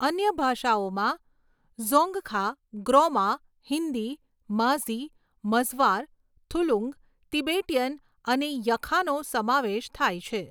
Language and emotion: Gujarati, neutral